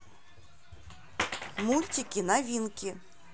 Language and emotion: Russian, neutral